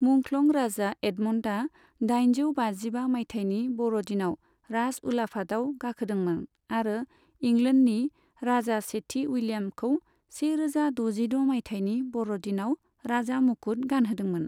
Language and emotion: Bodo, neutral